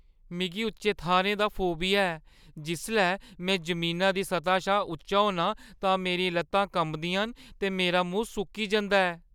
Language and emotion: Dogri, fearful